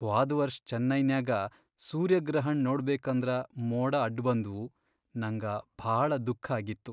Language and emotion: Kannada, sad